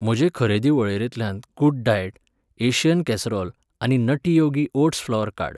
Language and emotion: Goan Konkani, neutral